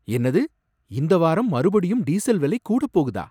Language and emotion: Tamil, surprised